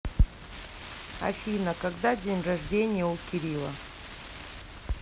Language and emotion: Russian, neutral